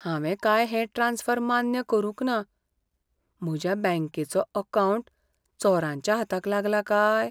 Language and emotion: Goan Konkani, fearful